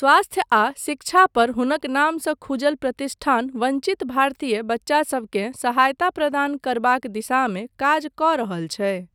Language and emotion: Maithili, neutral